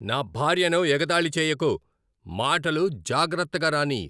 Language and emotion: Telugu, angry